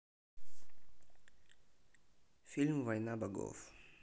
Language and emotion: Russian, neutral